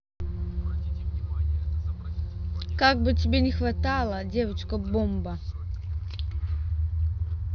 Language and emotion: Russian, neutral